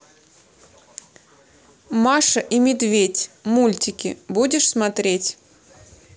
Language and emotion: Russian, neutral